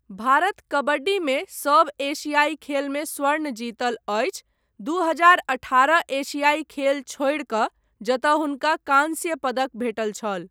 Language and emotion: Maithili, neutral